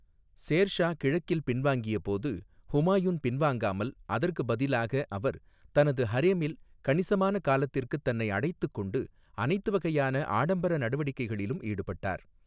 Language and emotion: Tamil, neutral